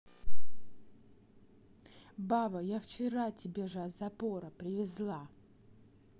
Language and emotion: Russian, angry